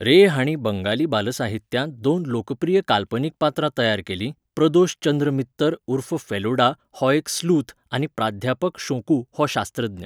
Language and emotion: Goan Konkani, neutral